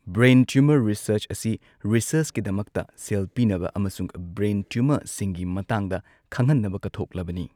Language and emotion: Manipuri, neutral